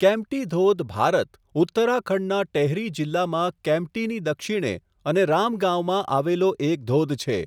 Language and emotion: Gujarati, neutral